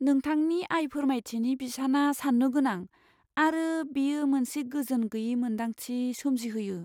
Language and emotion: Bodo, fearful